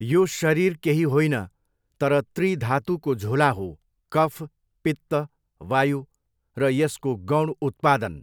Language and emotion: Nepali, neutral